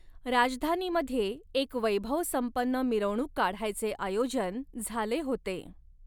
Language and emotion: Marathi, neutral